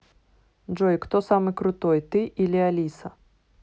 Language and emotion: Russian, neutral